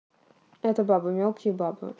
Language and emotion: Russian, neutral